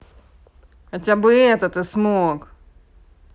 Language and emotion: Russian, angry